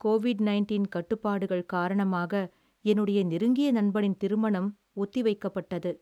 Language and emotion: Tamil, sad